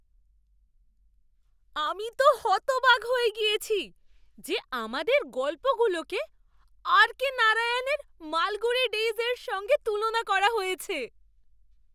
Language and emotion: Bengali, surprised